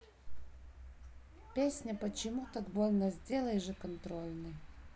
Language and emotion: Russian, neutral